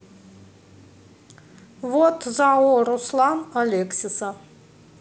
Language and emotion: Russian, neutral